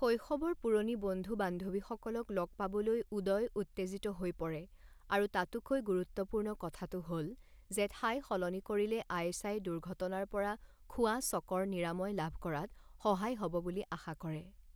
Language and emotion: Assamese, neutral